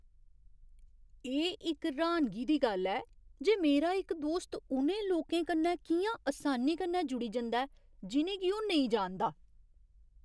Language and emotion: Dogri, surprised